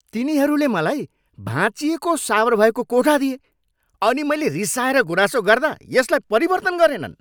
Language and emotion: Nepali, angry